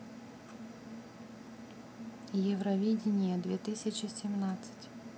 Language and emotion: Russian, neutral